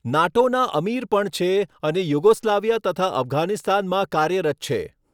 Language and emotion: Gujarati, neutral